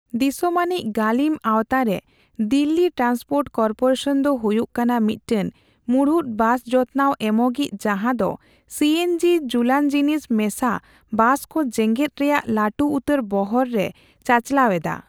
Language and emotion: Santali, neutral